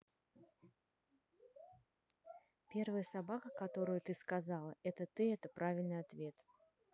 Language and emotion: Russian, neutral